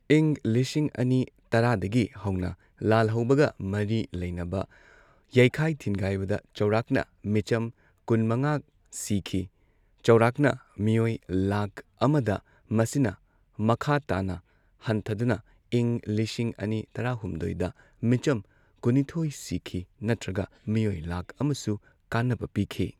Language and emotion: Manipuri, neutral